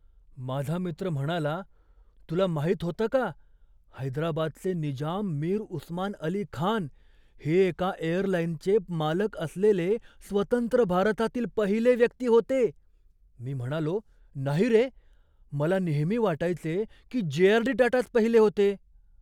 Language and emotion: Marathi, surprised